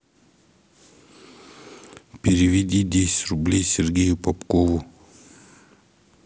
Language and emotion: Russian, neutral